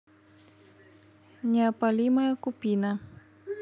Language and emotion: Russian, neutral